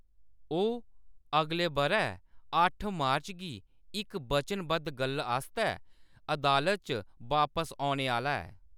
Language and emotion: Dogri, neutral